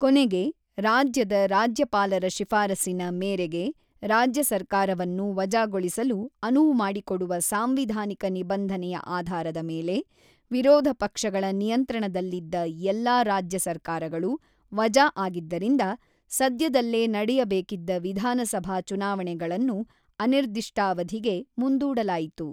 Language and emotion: Kannada, neutral